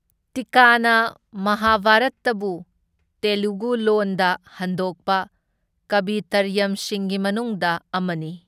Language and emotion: Manipuri, neutral